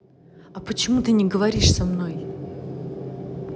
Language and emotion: Russian, angry